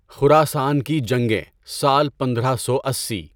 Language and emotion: Urdu, neutral